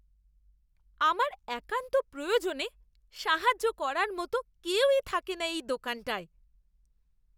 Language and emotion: Bengali, disgusted